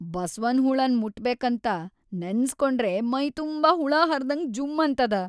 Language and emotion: Kannada, disgusted